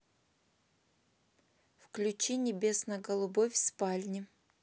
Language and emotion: Russian, neutral